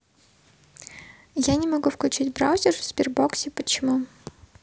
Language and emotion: Russian, neutral